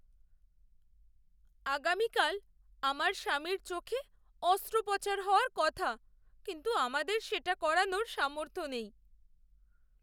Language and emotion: Bengali, sad